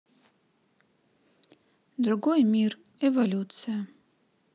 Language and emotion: Russian, neutral